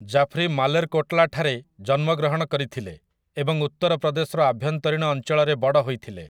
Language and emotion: Odia, neutral